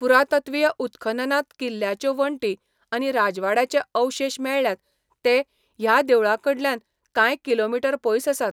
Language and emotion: Goan Konkani, neutral